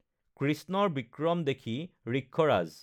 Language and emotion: Assamese, neutral